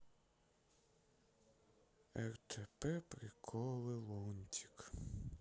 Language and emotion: Russian, sad